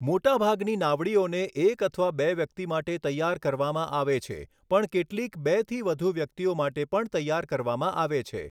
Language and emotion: Gujarati, neutral